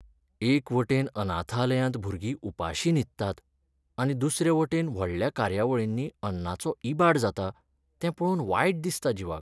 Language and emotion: Goan Konkani, sad